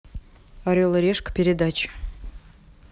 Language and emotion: Russian, neutral